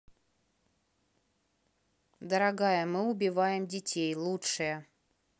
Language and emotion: Russian, neutral